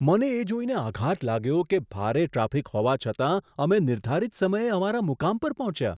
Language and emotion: Gujarati, surprised